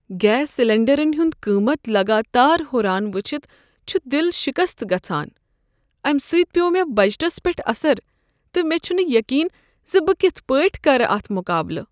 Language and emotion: Kashmiri, sad